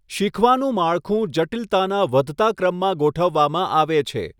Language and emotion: Gujarati, neutral